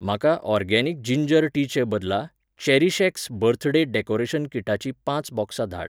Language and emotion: Goan Konkani, neutral